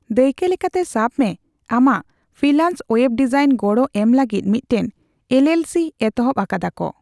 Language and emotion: Santali, neutral